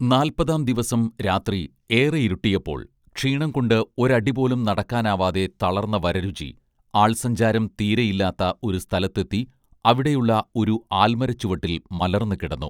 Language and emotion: Malayalam, neutral